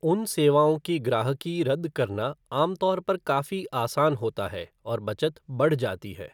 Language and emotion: Hindi, neutral